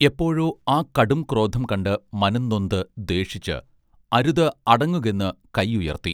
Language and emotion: Malayalam, neutral